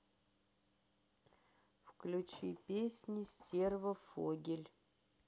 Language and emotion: Russian, neutral